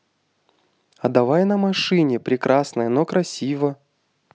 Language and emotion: Russian, neutral